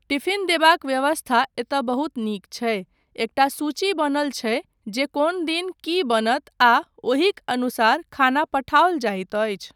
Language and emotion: Maithili, neutral